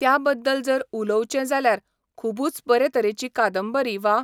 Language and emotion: Goan Konkani, neutral